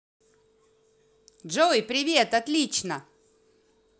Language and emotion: Russian, positive